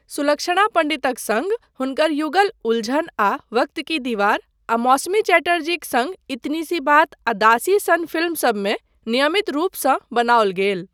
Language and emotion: Maithili, neutral